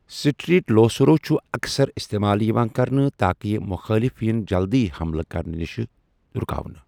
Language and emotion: Kashmiri, neutral